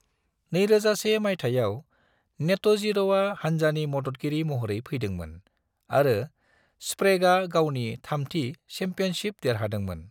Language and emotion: Bodo, neutral